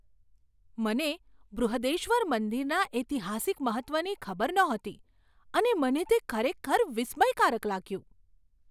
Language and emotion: Gujarati, surprised